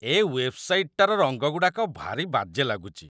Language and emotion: Odia, disgusted